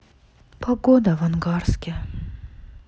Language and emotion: Russian, sad